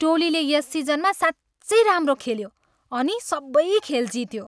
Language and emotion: Nepali, happy